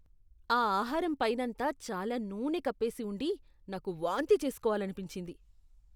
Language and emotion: Telugu, disgusted